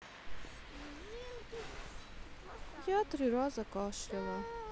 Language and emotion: Russian, sad